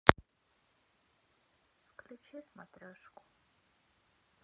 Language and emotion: Russian, sad